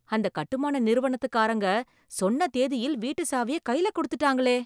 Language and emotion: Tamil, surprised